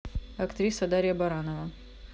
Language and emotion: Russian, neutral